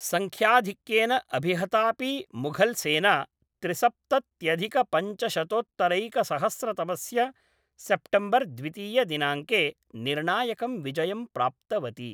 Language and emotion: Sanskrit, neutral